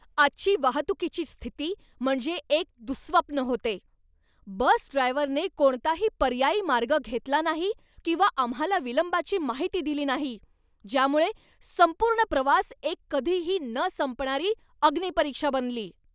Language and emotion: Marathi, angry